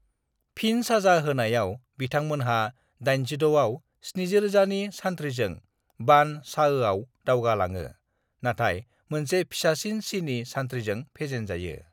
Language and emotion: Bodo, neutral